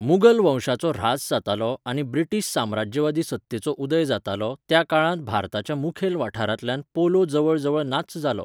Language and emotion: Goan Konkani, neutral